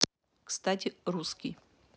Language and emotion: Russian, neutral